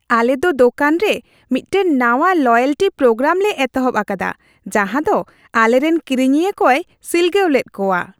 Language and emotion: Santali, happy